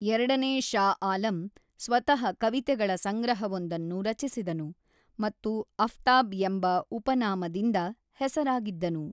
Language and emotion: Kannada, neutral